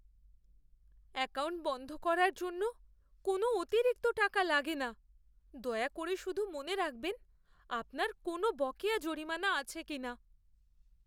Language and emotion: Bengali, fearful